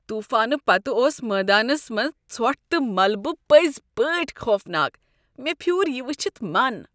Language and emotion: Kashmiri, disgusted